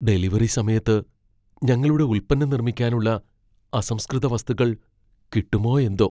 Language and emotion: Malayalam, fearful